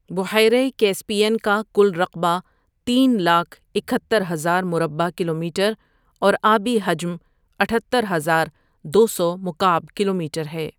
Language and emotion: Urdu, neutral